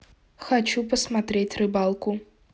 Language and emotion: Russian, neutral